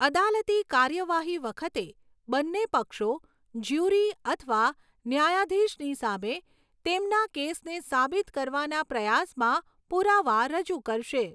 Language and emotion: Gujarati, neutral